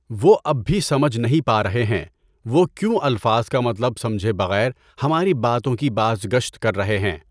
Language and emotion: Urdu, neutral